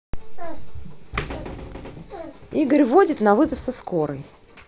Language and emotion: Russian, neutral